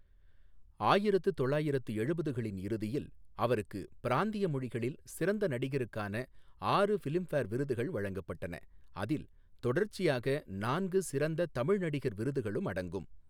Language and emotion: Tamil, neutral